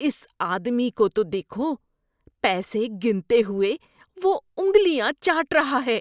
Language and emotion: Urdu, disgusted